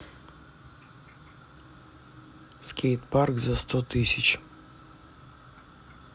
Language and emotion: Russian, neutral